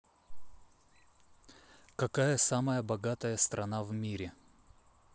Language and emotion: Russian, neutral